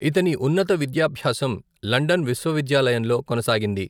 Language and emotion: Telugu, neutral